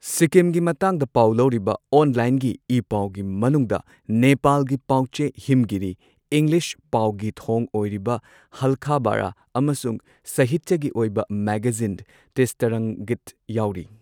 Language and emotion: Manipuri, neutral